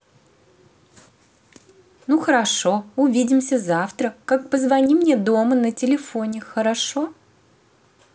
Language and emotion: Russian, positive